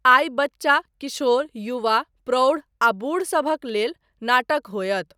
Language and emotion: Maithili, neutral